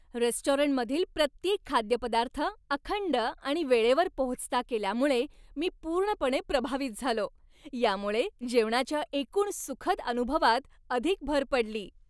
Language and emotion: Marathi, happy